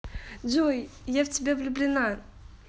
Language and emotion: Russian, positive